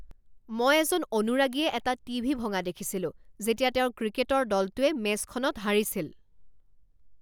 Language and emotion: Assamese, angry